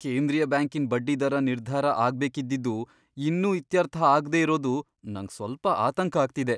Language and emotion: Kannada, fearful